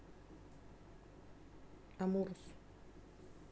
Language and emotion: Russian, neutral